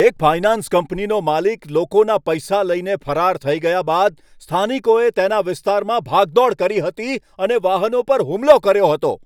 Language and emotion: Gujarati, angry